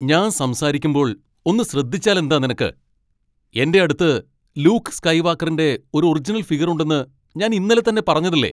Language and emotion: Malayalam, angry